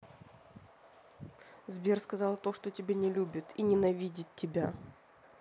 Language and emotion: Russian, angry